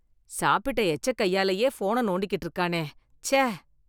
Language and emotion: Tamil, disgusted